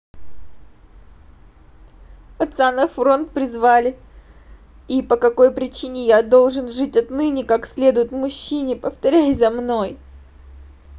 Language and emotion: Russian, sad